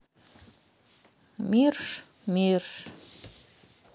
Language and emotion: Russian, sad